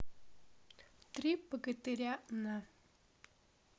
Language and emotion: Russian, neutral